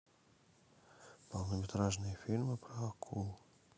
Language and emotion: Russian, neutral